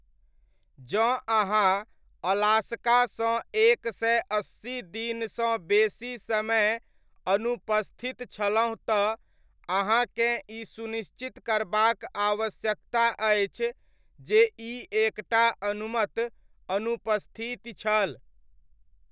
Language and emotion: Maithili, neutral